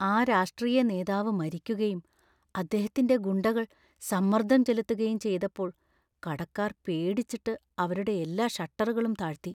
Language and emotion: Malayalam, fearful